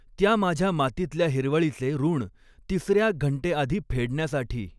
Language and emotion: Marathi, neutral